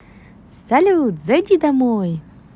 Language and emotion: Russian, positive